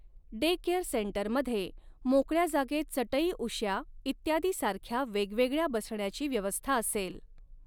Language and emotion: Marathi, neutral